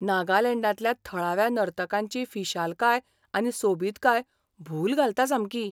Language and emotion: Goan Konkani, surprised